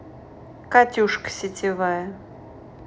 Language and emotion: Russian, neutral